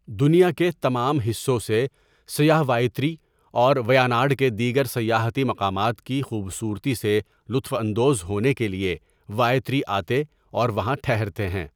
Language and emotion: Urdu, neutral